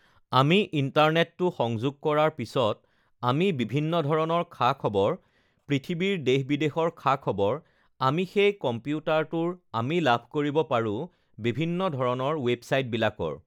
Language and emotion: Assamese, neutral